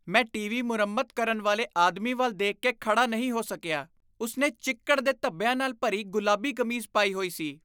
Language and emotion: Punjabi, disgusted